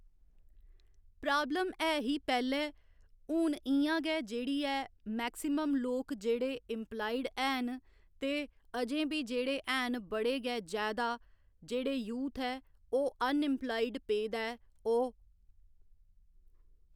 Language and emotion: Dogri, neutral